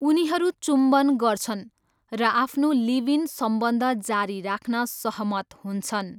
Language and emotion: Nepali, neutral